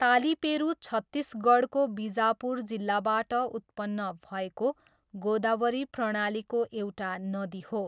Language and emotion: Nepali, neutral